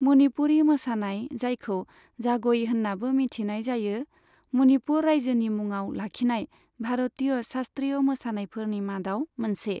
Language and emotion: Bodo, neutral